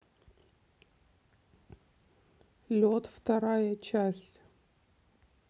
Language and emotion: Russian, neutral